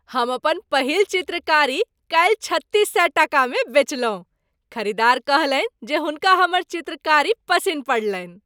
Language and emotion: Maithili, happy